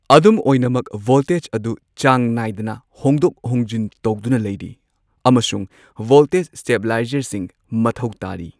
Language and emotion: Manipuri, neutral